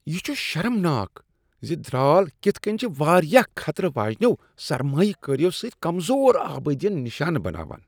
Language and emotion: Kashmiri, disgusted